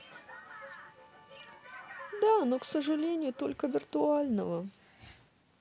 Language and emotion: Russian, sad